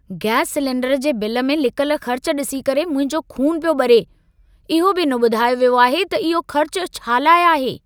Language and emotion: Sindhi, angry